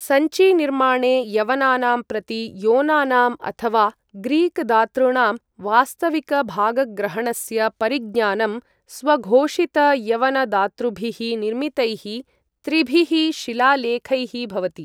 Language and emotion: Sanskrit, neutral